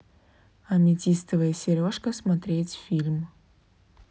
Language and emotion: Russian, neutral